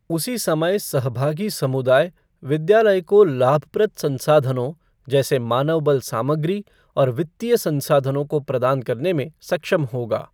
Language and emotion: Hindi, neutral